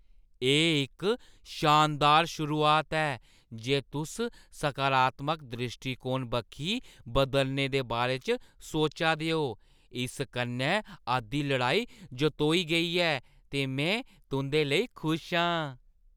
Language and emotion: Dogri, happy